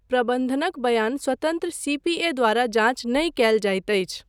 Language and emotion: Maithili, neutral